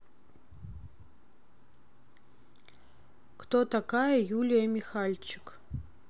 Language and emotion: Russian, neutral